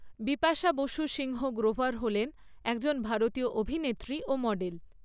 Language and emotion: Bengali, neutral